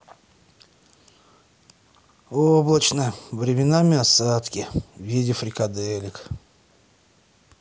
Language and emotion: Russian, sad